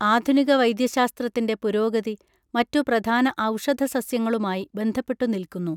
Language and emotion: Malayalam, neutral